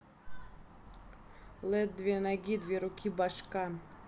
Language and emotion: Russian, neutral